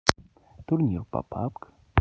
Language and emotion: Russian, neutral